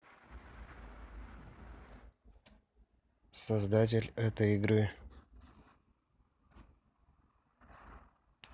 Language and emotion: Russian, neutral